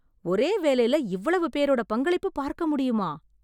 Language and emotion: Tamil, surprised